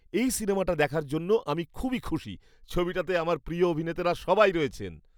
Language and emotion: Bengali, happy